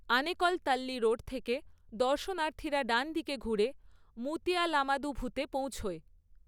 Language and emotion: Bengali, neutral